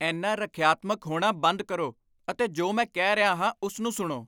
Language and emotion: Punjabi, angry